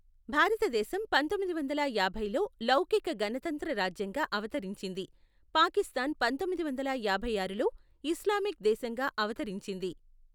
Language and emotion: Telugu, neutral